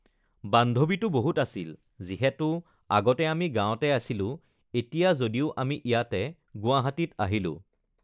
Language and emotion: Assamese, neutral